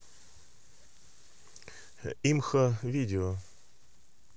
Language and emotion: Russian, neutral